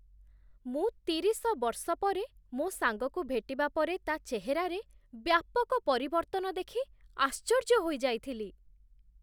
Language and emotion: Odia, surprised